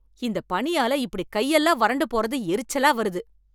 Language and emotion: Tamil, angry